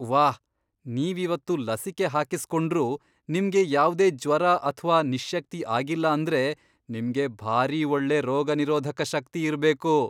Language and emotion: Kannada, surprised